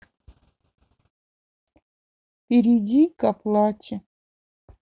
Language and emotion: Russian, sad